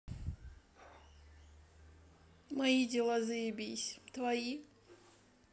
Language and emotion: Russian, neutral